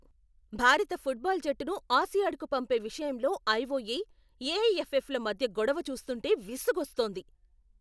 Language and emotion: Telugu, angry